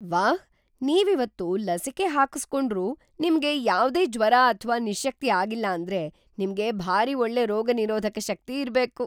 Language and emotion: Kannada, surprised